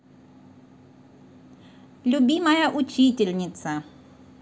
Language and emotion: Russian, positive